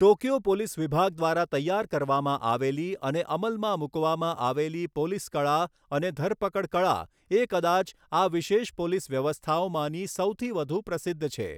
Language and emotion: Gujarati, neutral